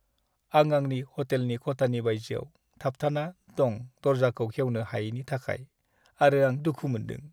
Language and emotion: Bodo, sad